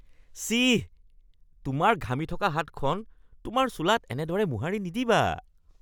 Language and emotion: Assamese, disgusted